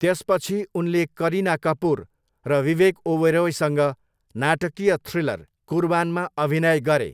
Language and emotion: Nepali, neutral